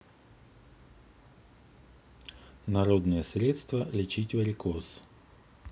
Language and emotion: Russian, neutral